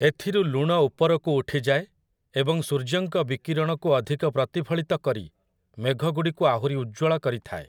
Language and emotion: Odia, neutral